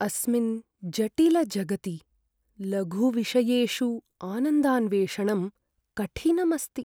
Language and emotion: Sanskrit, sad